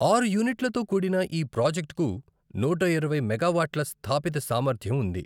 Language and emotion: Telugu, neutral